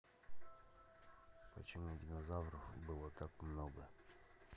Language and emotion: Russian, neutral